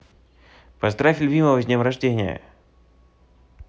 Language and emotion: Russian, positive